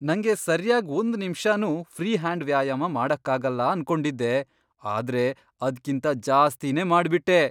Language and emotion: Kannada, surprised